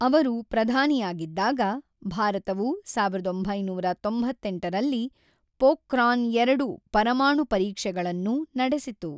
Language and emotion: Kannada, neutral